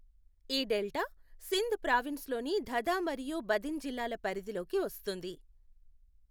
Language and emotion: Telugu, neutral